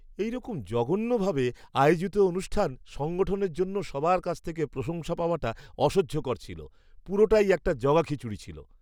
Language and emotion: Bengali, disgusted